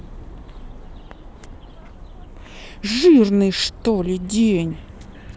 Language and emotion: Russian, angry